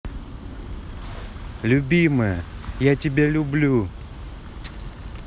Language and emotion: Russian, positive